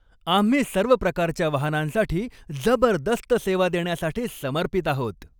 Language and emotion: Marathi, happy